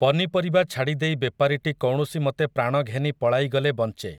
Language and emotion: Odia, neutral